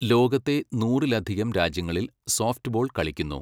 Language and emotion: Malayalam, neutral